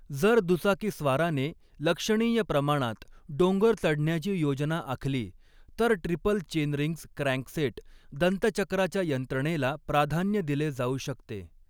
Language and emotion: Marathi, neutral